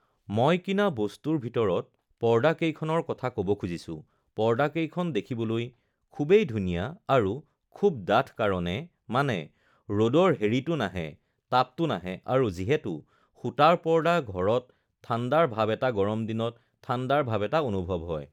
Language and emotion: Assamese, neutral